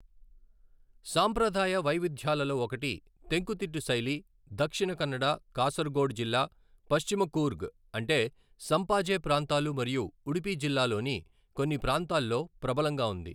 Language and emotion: Telugu, neutral